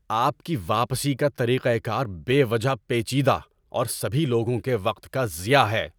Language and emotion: Urdu, angry